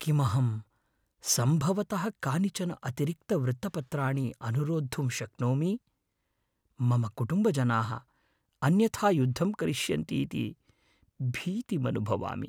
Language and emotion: Sanskrit, fearful